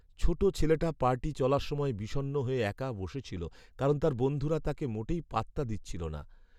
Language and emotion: Bengali, sad